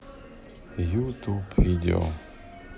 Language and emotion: Russian, neutral